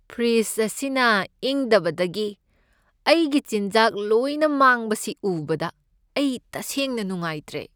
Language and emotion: Manipuri, sad